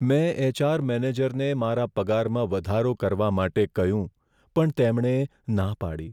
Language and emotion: Gujarati, sad